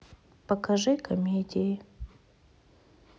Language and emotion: Russian, sad